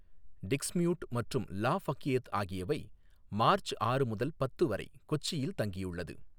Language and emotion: Tamil, neutral